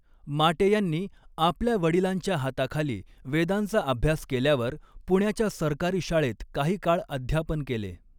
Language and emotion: Marathi, neutral